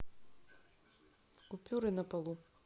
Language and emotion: Russian, neutral